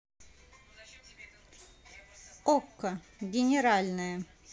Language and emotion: Russian, neutral